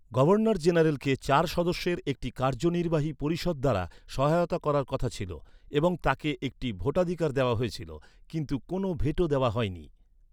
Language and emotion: Bengali, neutral